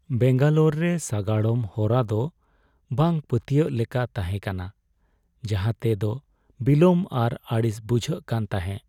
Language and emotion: Santali, sad